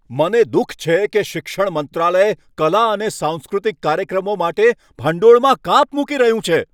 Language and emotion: Gujarati, angry